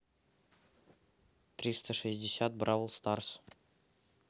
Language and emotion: Russian, neutral